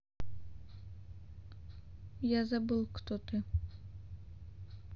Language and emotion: Russian, neutral